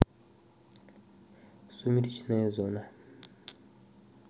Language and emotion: Russian, neutral